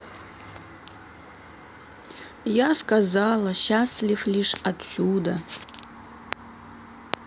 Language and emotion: Russian, neutral